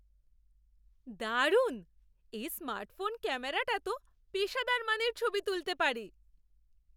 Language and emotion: Bengali, surprised